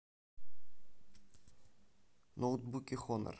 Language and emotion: Russian, neutral